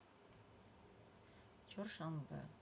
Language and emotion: Russian, neutral